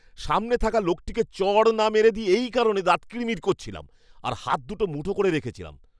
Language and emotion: Bengali, angry